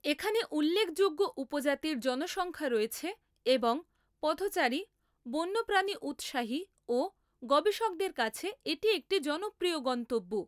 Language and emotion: Bengali, neutral